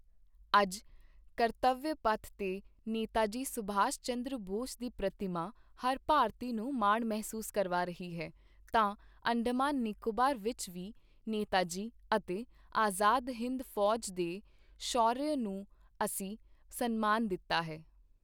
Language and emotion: Punjabi, neutral